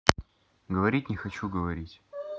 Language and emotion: Russian, neutral